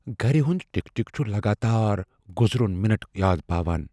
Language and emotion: Kashmiri, fearful